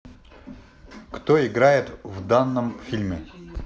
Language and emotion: Russian, neutral